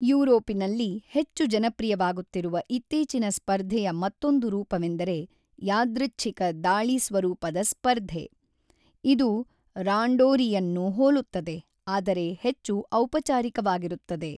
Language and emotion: Kannada, neutral